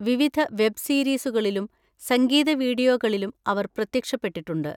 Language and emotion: Malayalam, neutral